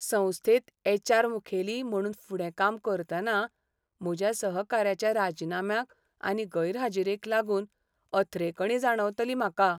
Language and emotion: Goan Konkani, sad